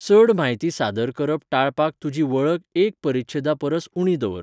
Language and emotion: Goan Konkani, neutral